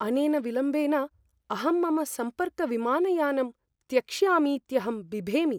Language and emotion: Sanskrit, fearful